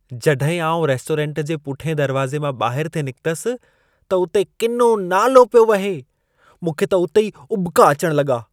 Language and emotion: Sindhi, disgusted